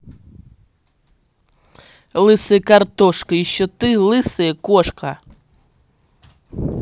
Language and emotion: Russian, angry